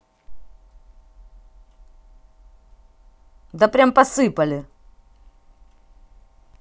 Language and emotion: Russian, angry